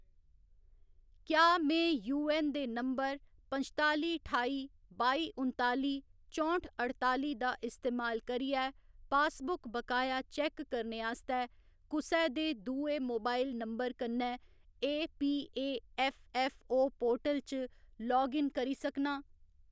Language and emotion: Dogri, neutral